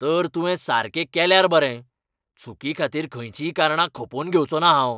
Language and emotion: Goan Konkani, angry